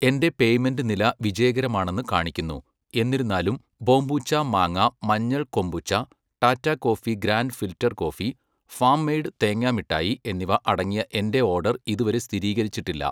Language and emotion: Malayalam, neutral